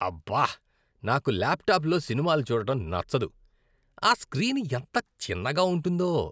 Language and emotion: Telugu, disgusted